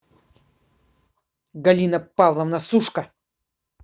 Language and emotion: Russian, angry